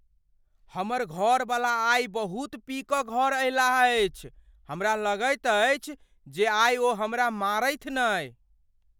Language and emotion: Maithili, fearful